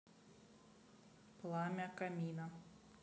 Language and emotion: Russian, neutral